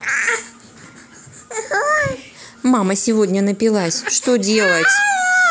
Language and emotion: Russian, neutral